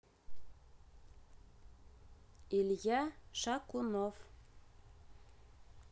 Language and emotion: Russian, neutral